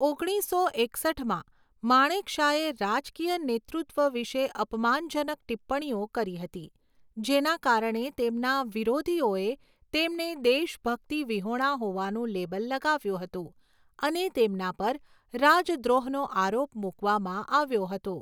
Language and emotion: Gujarati, neutral